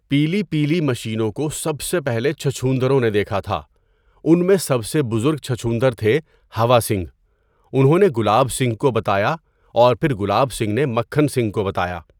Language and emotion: Urdu, neutral